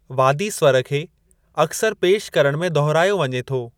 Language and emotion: Sindhi, neutral